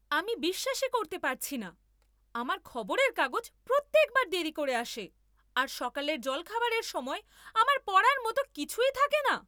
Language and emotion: Bengali, angry